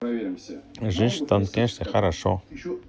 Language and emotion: Russian, neutral